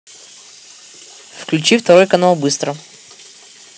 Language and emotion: Russian, neutral